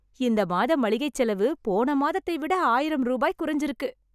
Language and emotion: Tamil, happy